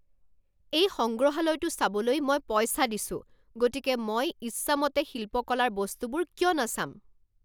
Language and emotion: Assamese, angry